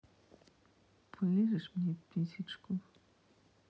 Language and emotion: Russian, sad